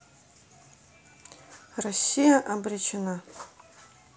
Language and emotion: Russian, neutral